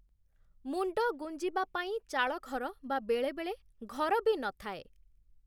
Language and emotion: Odia, neutral